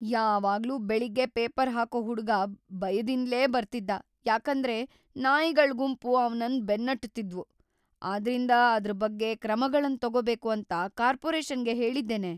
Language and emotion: Kannada, fearful